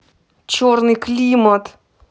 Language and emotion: Russian, angry